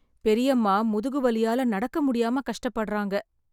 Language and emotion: Tamil, sad